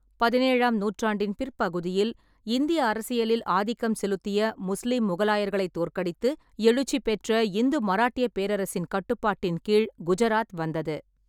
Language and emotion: Tamil, neutral